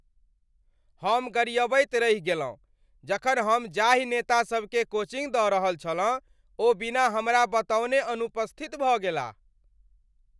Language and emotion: Maithili, angry